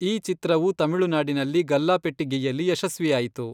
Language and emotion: Kannada, neutral